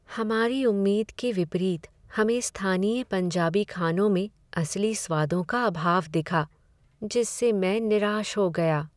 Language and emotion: Hindi, sad